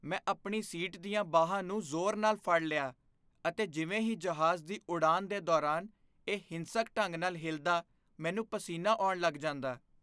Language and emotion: Punjabi, fearful